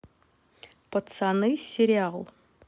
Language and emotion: Russian, neutral